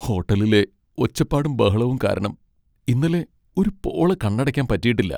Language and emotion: Malayalam, sad